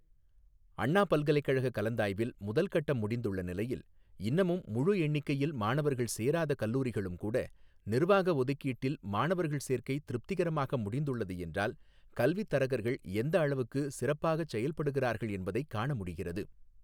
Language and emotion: Tamil, neutral